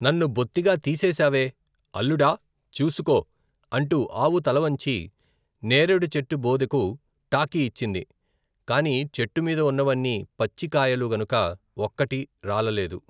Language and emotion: Telugu, neutral